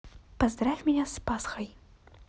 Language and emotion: Russian, neutral